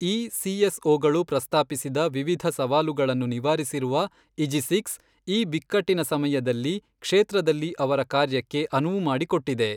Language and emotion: Kannada, neutral